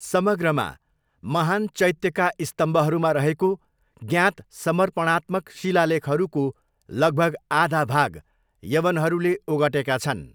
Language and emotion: Nepali, neutral